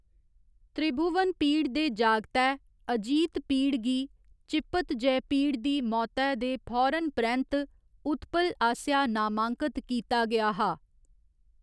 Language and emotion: Dogri, neutral